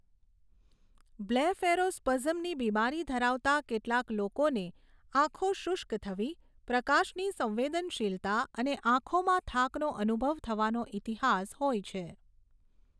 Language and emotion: Gujarati, neutral